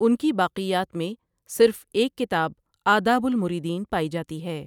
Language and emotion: Urdu, neutral